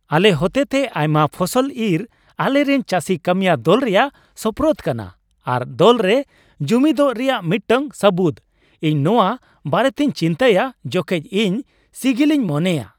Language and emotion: Santali, happy